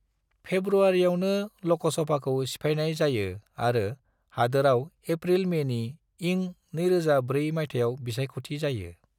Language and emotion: Bodo, neutral